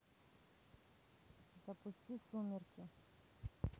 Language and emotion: Russian, neutral